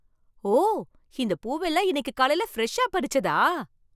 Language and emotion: Tamil, surprised